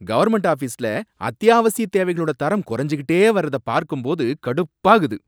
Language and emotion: Tamil, angry